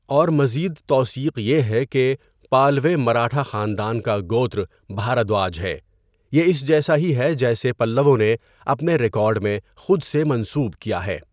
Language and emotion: Urdu, neutral